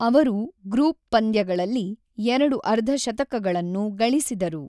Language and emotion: Kannada, neutral